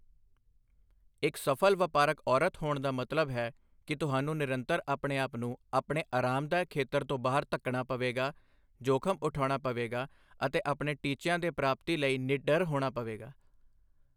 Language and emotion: Punjabi, neutral